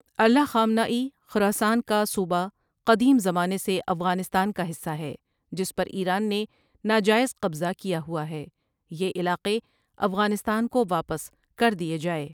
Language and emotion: Urdu, neutral